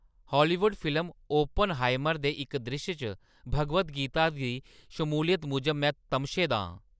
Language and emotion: Dogri, angry